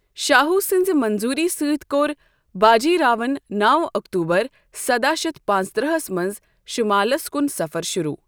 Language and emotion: Kashmiri, neutral